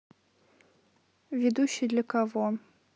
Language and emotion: Russian, neutral